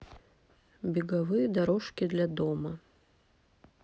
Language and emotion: Russian, neutral